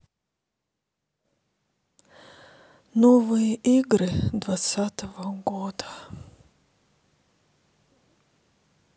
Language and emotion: Russian, sad